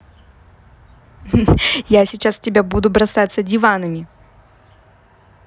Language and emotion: Russian, positive